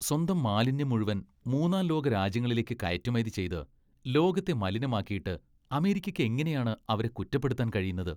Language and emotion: Malayalam, disgusted